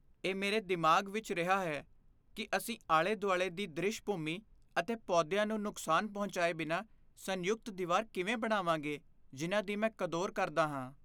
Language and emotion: Punjabi, fearful